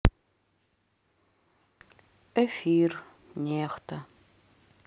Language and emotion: Russian, sad